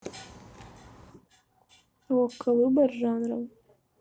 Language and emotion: Russian, neutral